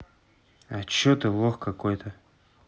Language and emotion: Russian, neutral